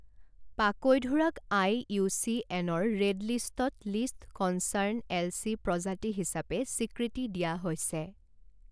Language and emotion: Assamese, neutral